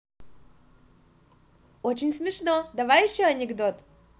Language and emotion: Russian, positive